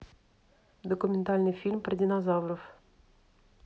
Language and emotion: Russian, neutral